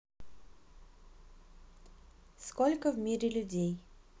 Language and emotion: Russian, neutral